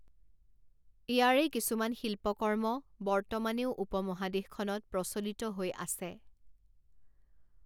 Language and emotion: Assamese, neutral